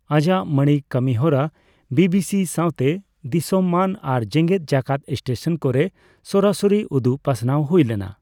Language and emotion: Santali, neutral